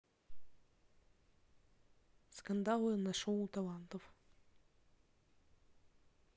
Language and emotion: Russian, neutral